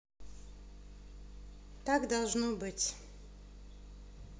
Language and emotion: Russian, neutral